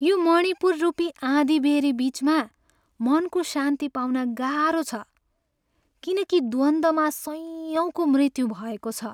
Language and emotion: Nepali, sad